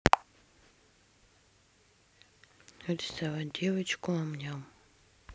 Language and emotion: Russian, neutral